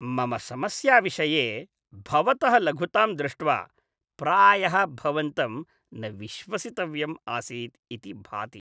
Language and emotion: Sanskrit, disgusted